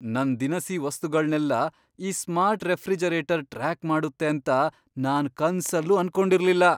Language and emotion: Kannada, surprised